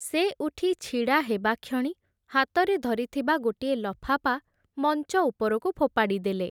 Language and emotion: Odia, neutral